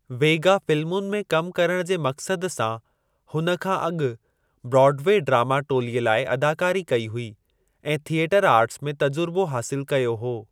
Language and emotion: Sindhi, neutral